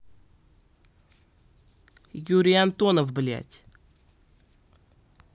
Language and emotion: Russian, angry